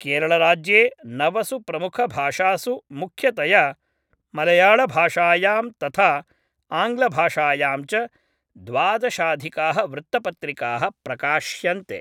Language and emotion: Sanskrit, neutral